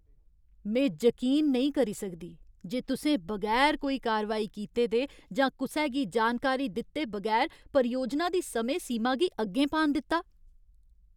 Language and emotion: Dogri, angry